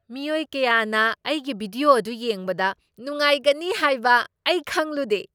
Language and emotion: Manipuri, surprised